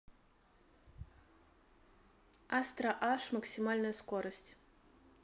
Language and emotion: Russian, neutral